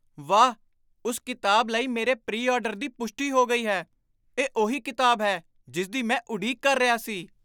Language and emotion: Punjabi, surprised